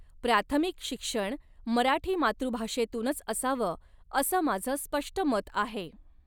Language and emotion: Marathi, neutral